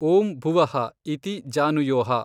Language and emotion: Kannada, neutral